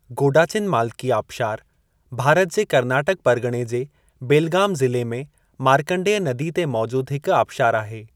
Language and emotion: Sindhi, neutral